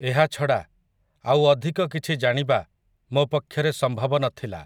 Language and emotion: Odia, neutral